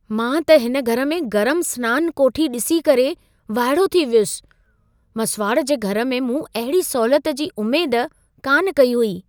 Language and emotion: Sindhi, surprised